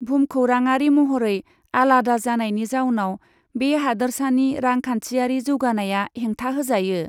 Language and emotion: Bodo, neutral